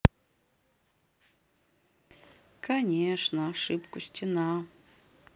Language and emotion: Russian, sad